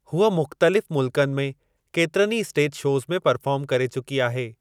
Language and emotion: Sindhi, neutral